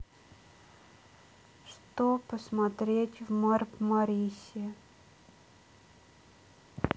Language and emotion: Russian, sad